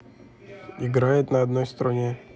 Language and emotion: Russian, neutral